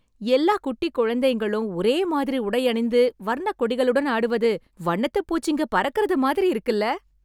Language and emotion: Tamil, happy